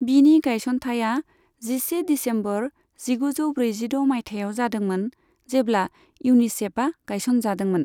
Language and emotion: Bodo, neutral